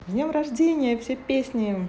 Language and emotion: Russian, positive